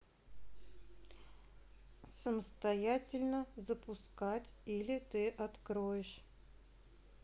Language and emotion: Russian, neutral